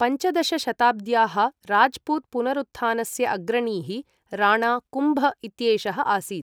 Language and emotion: Sanskrit, neutral